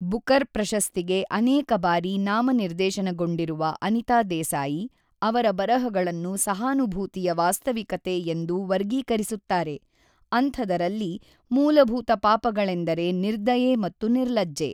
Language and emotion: Kannada, neutral